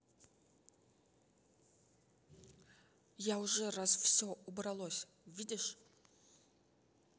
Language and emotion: Russian, angry